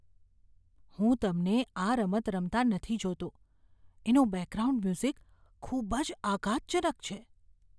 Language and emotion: Gujarati, fearful